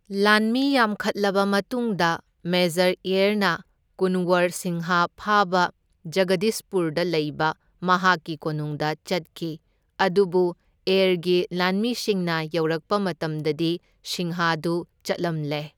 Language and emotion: Manipuri, neutral